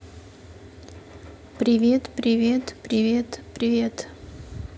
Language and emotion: Russian, neutral